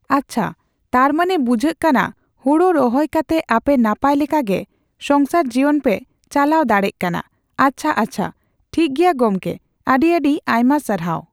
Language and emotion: Santali, neutral